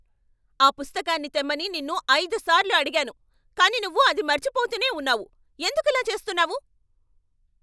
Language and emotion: Telugu, angry